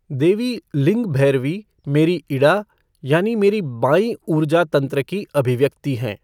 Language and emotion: Hindi, neutral